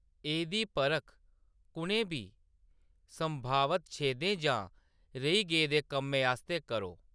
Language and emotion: Dogri, neutral